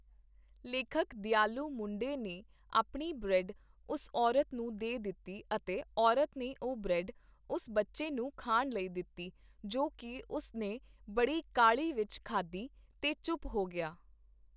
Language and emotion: Punjabi, neutral